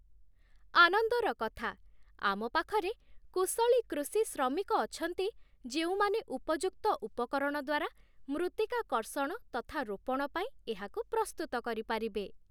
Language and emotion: Odia, happy